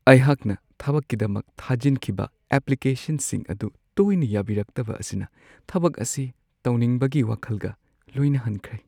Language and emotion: Manipuri, sad